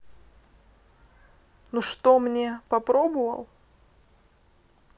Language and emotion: Russian, neutral